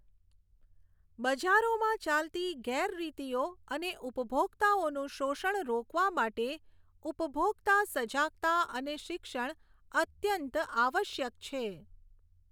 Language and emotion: Gujarati, neutral